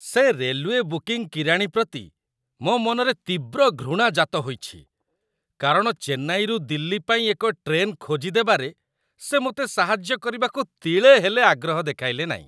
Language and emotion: Odia, disgusted